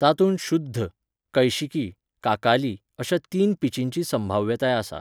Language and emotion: Goan Konkani, neutral